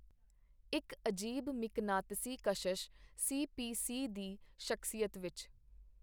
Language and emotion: Punjabi, neutral